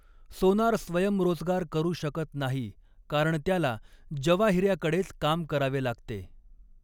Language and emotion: Marathi, neutral